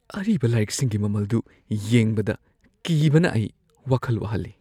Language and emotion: Manipuri, fearful